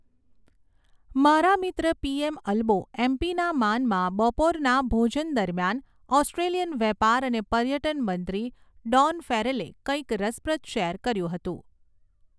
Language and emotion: Gujarati, neutral